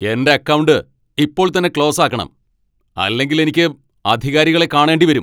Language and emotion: Malayalam, angry